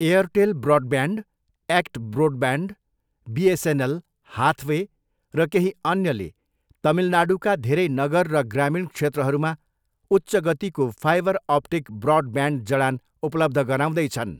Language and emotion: Nepali, neutral